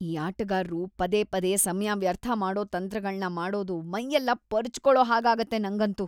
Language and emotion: Kannada, disgusted